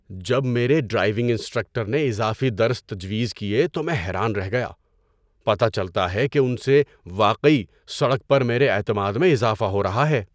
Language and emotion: Urdu, surprised